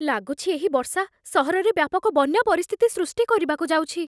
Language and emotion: Odia, fearful